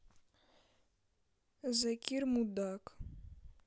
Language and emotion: Russian, neutral